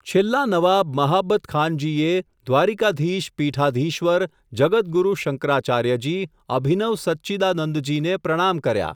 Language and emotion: Gujarati, neutral